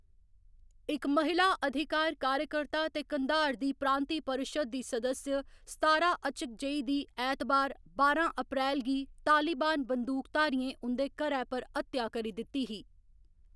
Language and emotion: Dogri, neutral